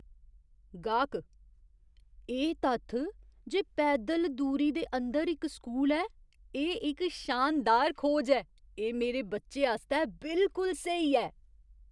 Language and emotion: Dogri, surprised